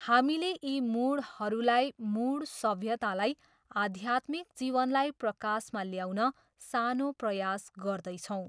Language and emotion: Nepali, neutral